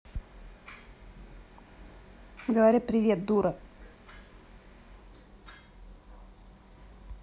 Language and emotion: Russian, angry